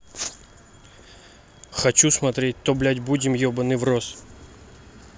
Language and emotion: Russian, angry